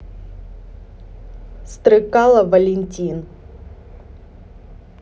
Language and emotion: Russian, neutral